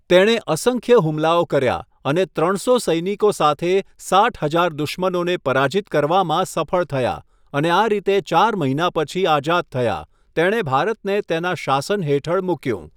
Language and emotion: Gujarati, neutral